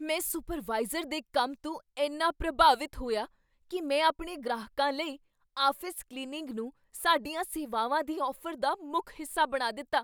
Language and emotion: Punjabi, surprised